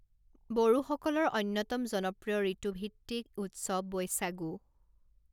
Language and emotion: Assamese, neutral